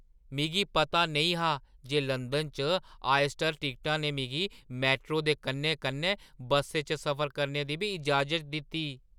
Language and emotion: Dogri, surprised